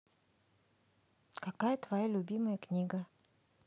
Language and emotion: Russian, neutral